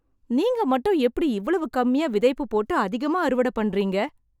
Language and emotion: Tamil, surprised